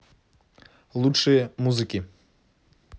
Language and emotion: Russian, neutral